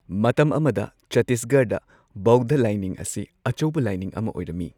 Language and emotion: Manipuri, neutral